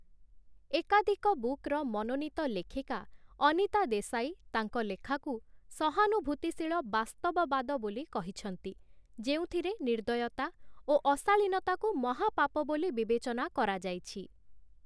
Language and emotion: Odia, neutral